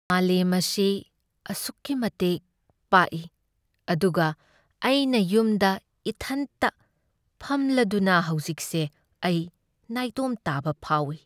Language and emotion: Manipuri, sad